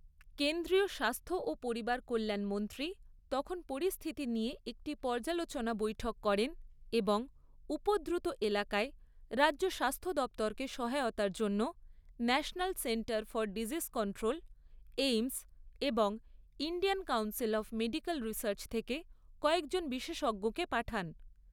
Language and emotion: Bengali, neutral